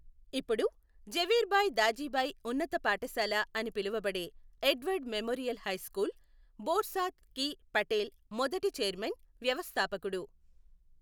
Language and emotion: Telugu, neutral